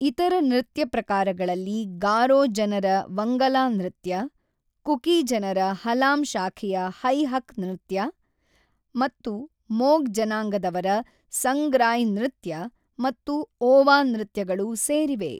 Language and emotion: Kannada, neutral